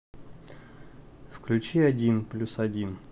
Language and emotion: Russian, neutral